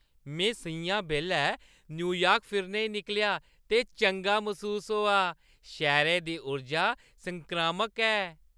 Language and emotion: Dogri, happy